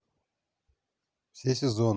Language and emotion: Russian, neutral